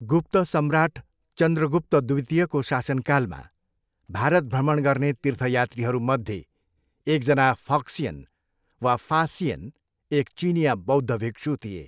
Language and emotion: Nepali, neutral